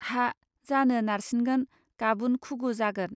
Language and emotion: Bodo, neutral